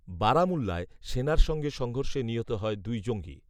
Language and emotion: Bengali, neutral